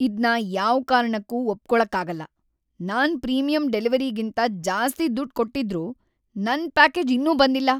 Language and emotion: Kannada, angry